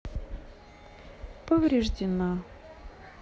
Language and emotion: Russian, sad